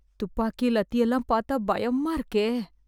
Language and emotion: Tamil, fearful